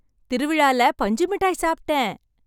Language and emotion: Tamil, happy